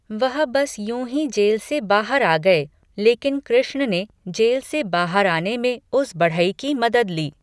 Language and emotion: Hindi, neutral